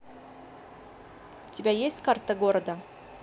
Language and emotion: Russian, neutral